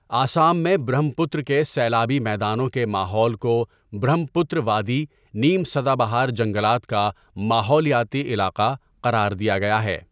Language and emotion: Urdu, neutral